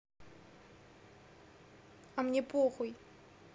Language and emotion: Russian, angry